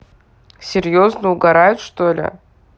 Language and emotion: Russian, neutral